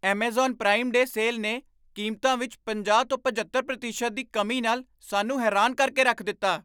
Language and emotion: Punjabi, surprised